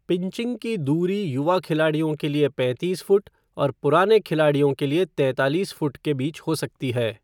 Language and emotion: Hindi, neutral